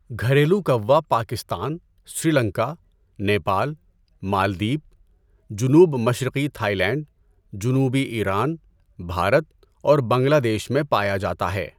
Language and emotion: Urdu, neutral